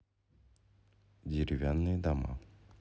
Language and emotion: Russian, neutral